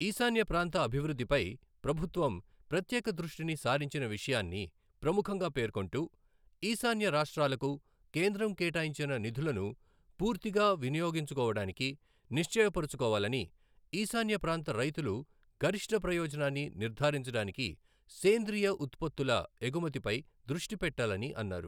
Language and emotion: Telugu, neutral